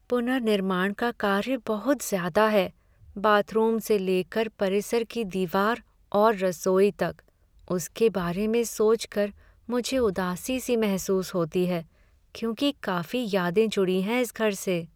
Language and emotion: Hindi, sad